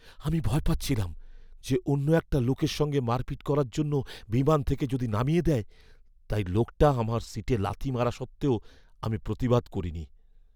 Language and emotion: Bengali, fearful